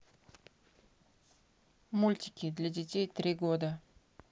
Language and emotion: Russian, neutral